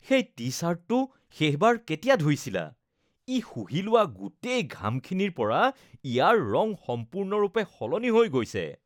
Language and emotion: Assamese, disgusted